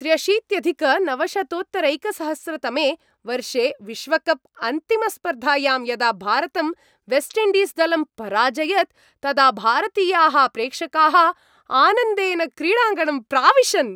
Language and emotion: Sanskrit, happy